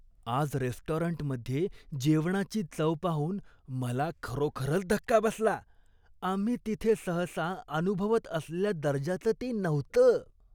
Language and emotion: Marathi, disgusted